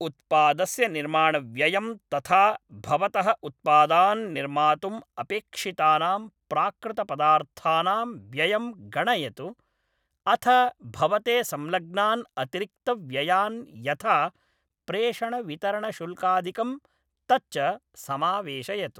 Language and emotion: Sanskrit, neutral